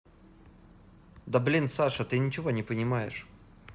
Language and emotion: Russian, angry